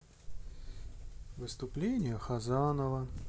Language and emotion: Russian, sad